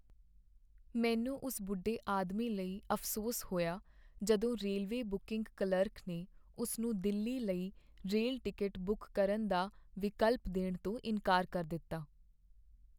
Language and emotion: Punjabi, sad